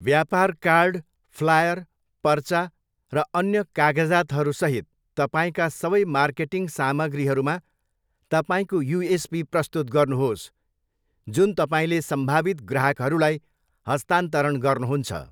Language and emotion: Nepali, neutral